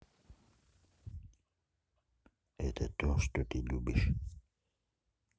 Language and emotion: Russian, neutral